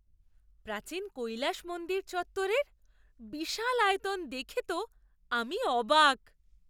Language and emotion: Bengali, surprised